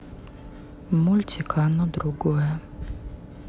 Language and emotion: Russian, neutral